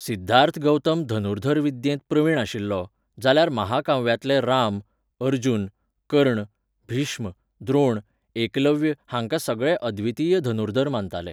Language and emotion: Goan Konkani, neutral